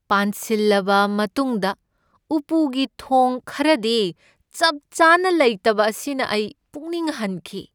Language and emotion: Manipuri, sad